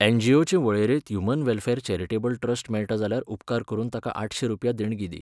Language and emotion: Goan Konkani, neutral